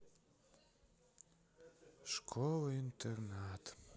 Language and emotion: Russian, sad